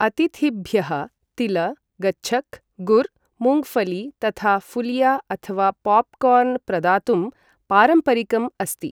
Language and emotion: Sanskrit, neutral